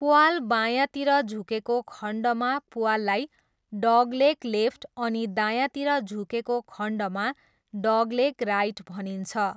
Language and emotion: Nepali, neutral